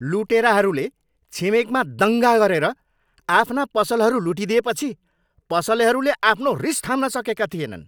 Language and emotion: Nepali, angry